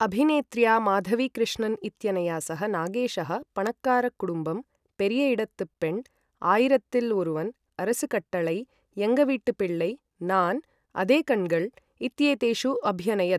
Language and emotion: Sanskrit, neutral